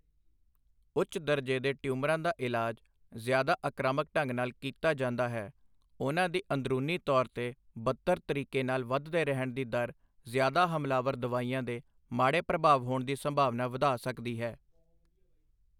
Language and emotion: Punjabi, neutral